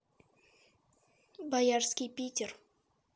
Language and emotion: Russian, neutral